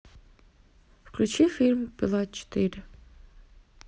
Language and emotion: Russian, neutral